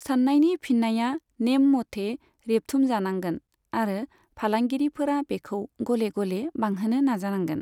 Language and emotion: Bodo, neutral